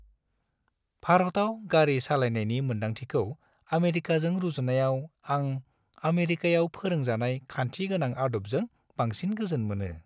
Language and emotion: Bodo, happy